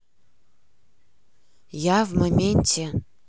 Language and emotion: Russian, neutral